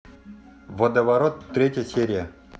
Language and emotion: Russian, neutral